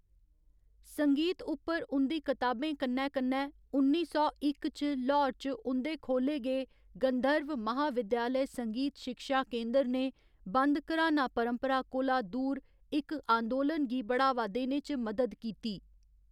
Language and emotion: Dogri, neutral